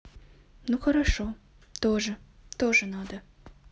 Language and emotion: Russian, neutral